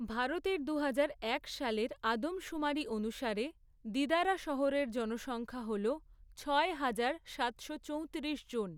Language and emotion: Bengali, neutral